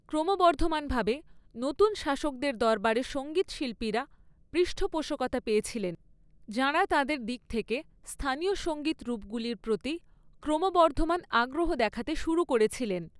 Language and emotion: Bengali, neutral